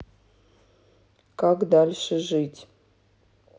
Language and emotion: Russian, neutral